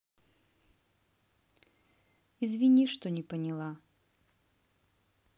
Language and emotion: Russian, sad